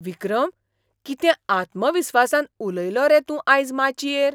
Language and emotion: Goan Konkani, surprised